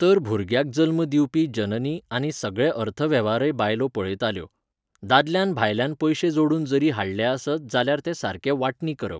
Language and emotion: Goan Konkani, neutral